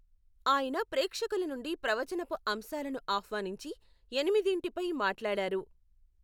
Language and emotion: Telugu, neutral